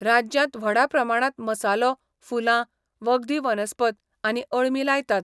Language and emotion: Goan Konkani, neutral